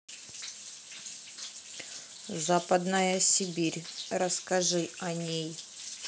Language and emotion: Russian, neutral